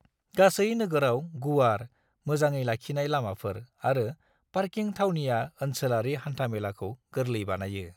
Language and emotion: Bodo, neutral